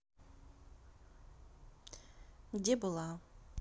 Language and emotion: Russian, neutral